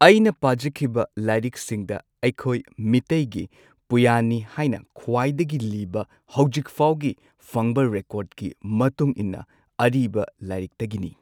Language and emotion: Manipuri, neutral